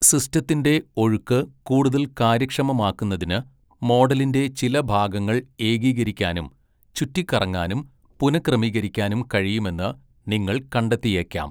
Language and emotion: Malayalam, neutral